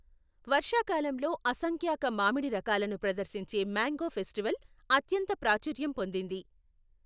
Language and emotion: Telugu, neutral